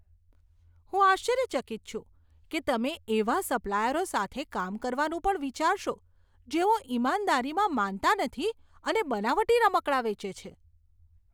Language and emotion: Gujarati, disgusted